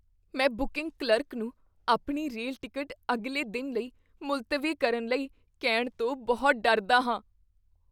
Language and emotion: Punjabi, fearful